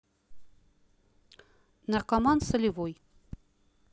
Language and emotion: Russian, neutral